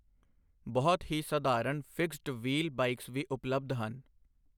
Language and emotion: Punjabi, neutral